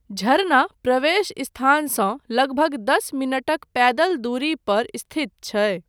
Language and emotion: Maithili, neutral